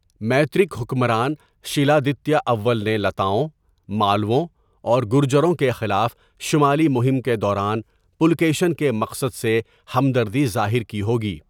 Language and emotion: Urdu, neutral